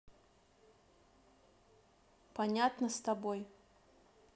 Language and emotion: Russian, neutral